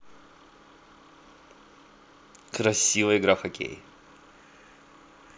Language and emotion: Russian, neutral